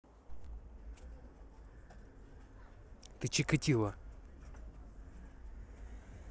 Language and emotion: Russian, angry